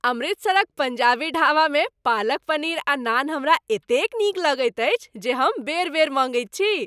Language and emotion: Maithili, happy